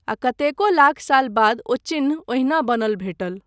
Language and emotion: Maithili, neutral